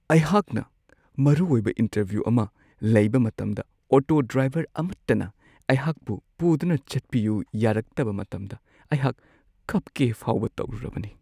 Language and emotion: Manipuri, sad